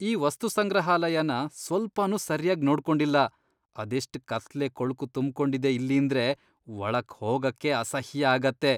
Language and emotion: Kannada, disgusted